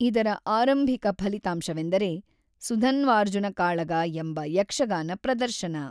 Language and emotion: Kannada, neutral